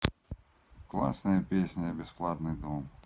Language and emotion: Russian, neutral